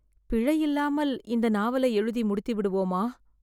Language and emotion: Tamil, fearful